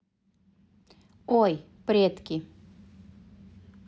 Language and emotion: Russian, neutral